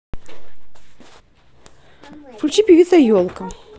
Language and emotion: Russian, neutral